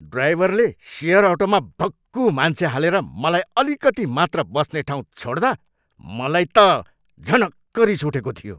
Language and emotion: Nepali, angry